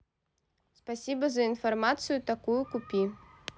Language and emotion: Russian, neutral